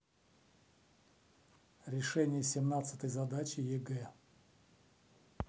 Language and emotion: Russian, neutral